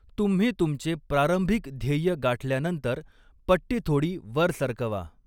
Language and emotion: Marathi, neutral